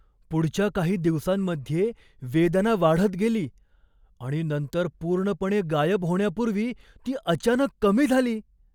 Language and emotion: Marathi, surprised